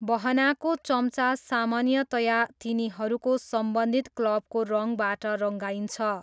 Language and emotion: Nepali, neutral